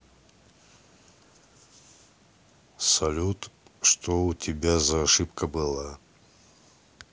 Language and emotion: Russian, neutral